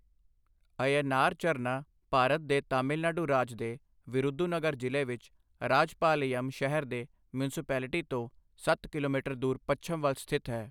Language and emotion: Punjabi, neutral